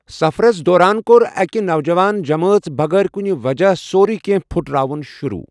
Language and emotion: Kashmiri, neutral